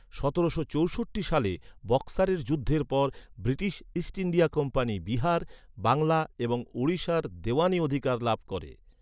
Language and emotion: Bengali, neutral